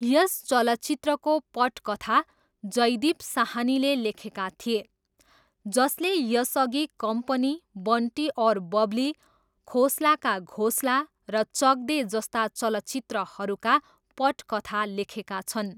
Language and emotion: Nepali, neutral